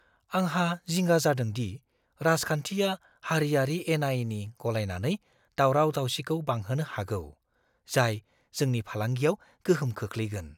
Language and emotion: Bodo, fearful